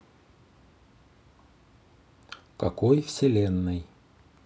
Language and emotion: Russian, neutral